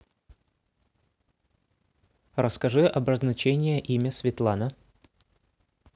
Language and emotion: Russian, neutral